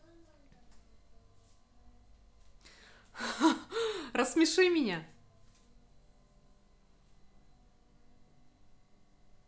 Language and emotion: Russian, positive